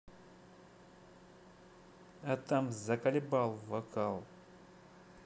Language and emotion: Russian, neutral